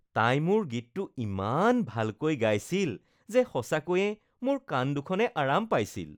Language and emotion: Assamese, happy